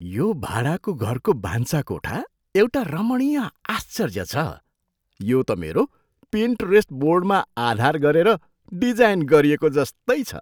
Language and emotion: Nepali, surprised